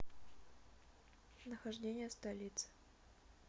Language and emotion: Russian, neutral